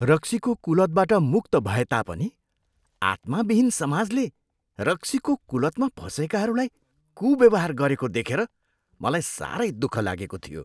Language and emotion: Nepali, disgusted